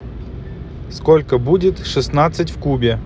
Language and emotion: Russian, neutral